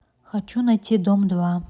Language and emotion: Russian, neutral